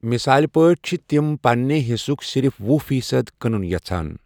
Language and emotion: Kashmiri, neutral